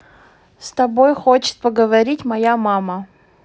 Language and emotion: Russian, neutral